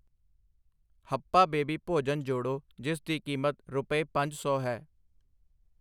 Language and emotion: Punjabi, neutral